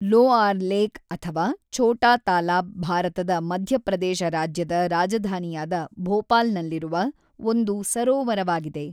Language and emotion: Kannada, neutral